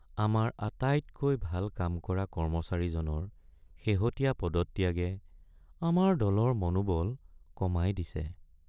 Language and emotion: Assamese, sad